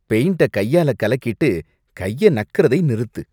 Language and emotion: Tamil, disgusted